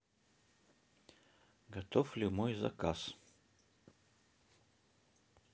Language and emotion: Russian, neutral